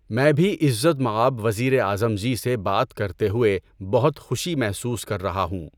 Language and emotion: Urdu, neutral